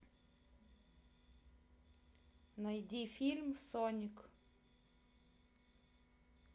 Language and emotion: Russian, neutral